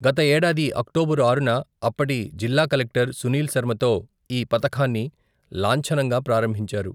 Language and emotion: Telugu, neutral